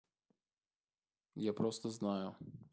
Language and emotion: Russian, neutral